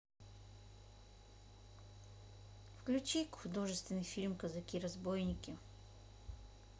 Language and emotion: Russian, neutral